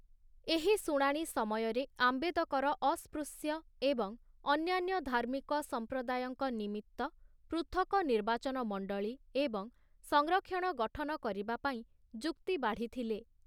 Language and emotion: Odia, neutral